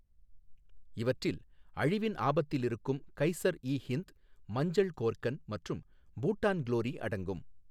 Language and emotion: Tamil, neutral